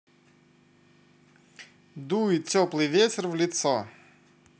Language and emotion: Russian, positive